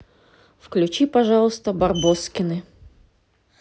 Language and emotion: Russian, neutral